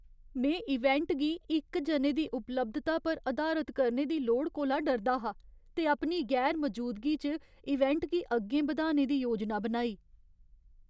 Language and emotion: Dogri, fearful